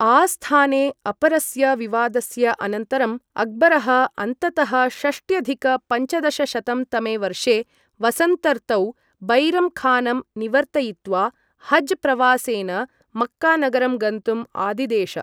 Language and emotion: Sanskrit, neutral